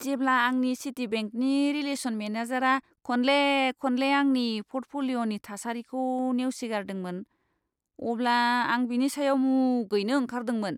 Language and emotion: Bodo, disgusted